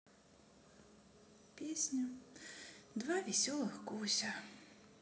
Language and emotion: Russian, sad